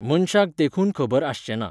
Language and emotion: Goan Konkani, neutral